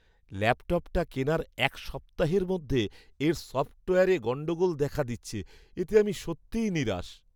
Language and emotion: Bengali, sad